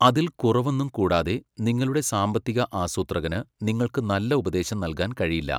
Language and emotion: Malayalam, neutral